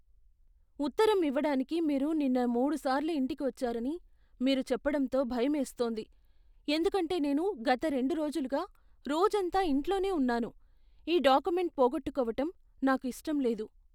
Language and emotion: Telugu, fearful